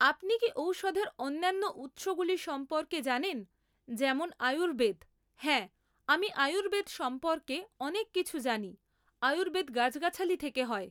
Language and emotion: Bengali, neutral